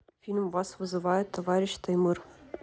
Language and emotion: Russian, neutral